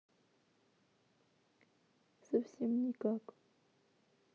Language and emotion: Russian, sad